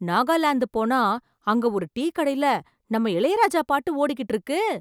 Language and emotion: Tamil, surprised